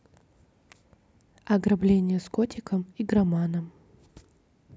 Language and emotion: Russian, neutral